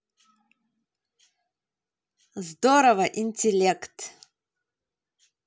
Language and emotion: Russian, positive